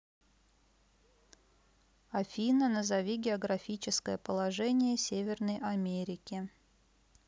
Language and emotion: Russian, neutral